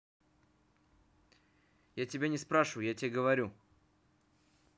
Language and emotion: Russian, angry